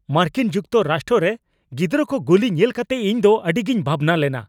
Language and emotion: Santali, angry